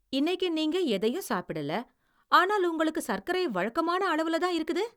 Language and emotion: Tamil, surprised